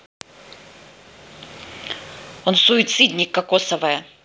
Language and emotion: Russian, angry